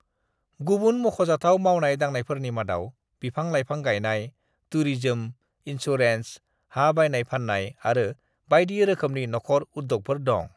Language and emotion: Bodo, neutral